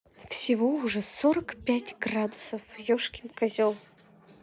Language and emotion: Russian, angry